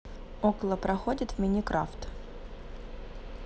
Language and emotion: Russian, neutral